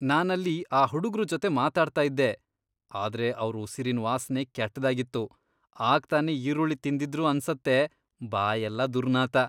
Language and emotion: Kannada, disgusted